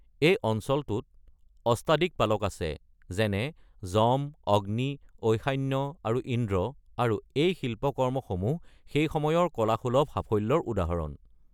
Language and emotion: Assamese, neutral